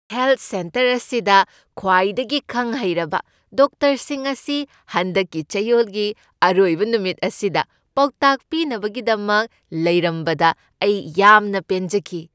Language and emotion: Manipuri, happy